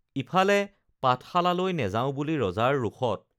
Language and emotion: Assamese, neutral